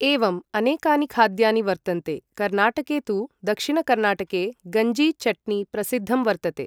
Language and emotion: Sanskrit, neutral